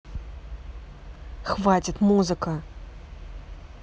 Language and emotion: Russian, angry